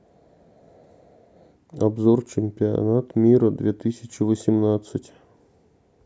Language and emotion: Russian, neutral